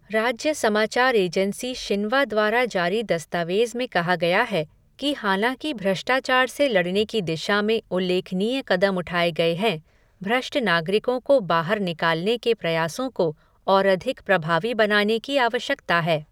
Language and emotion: Hindi, neutral